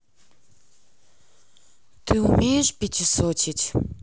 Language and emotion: Russian, neutral